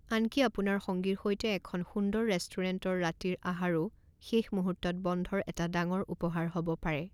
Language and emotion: Assamese, neutral